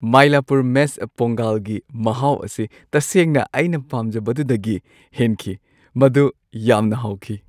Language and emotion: Manipuri, happy